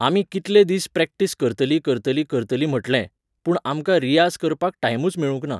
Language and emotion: Goan Konkani, neutral